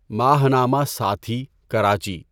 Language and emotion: Urdu, neutral